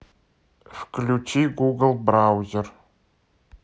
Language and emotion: Russian, neutral